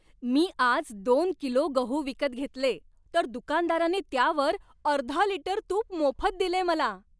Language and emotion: Marathi, happy